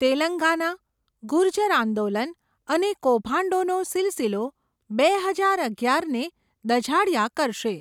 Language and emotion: Gujarati, neutral